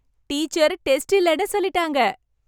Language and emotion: Tamil, happy